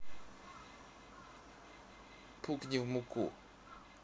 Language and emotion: Russian, neutral